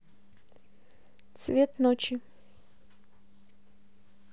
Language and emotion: Russian, neutral